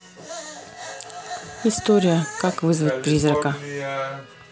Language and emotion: Russian, neutral